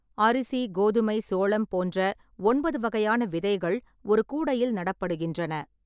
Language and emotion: Tamil, neutral